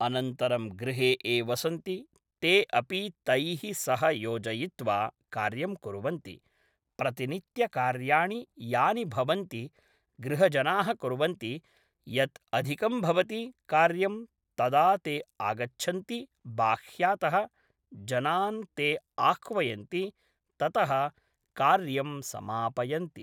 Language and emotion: Sanskrit, neutral